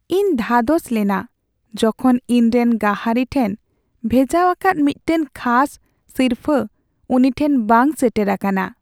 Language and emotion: Santali, sad